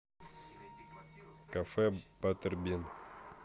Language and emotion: Russian, neutral